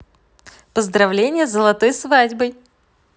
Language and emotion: Russian, positive